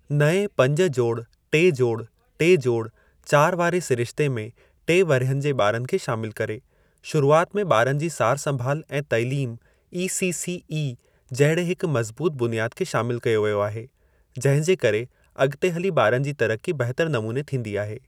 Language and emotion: Sindhi, neutral